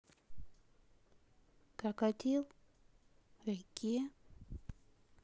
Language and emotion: Russian, sad